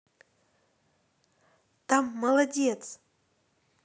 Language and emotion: Russian, positive